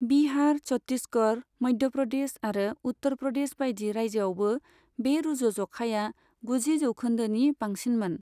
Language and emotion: Bodo, neutral